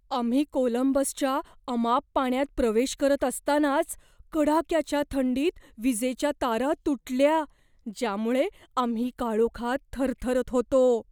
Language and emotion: Marathi, fearful